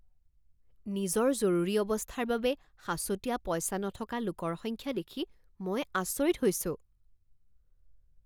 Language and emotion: Assamese, surprised